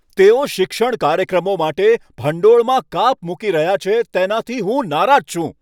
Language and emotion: Gujarati, angry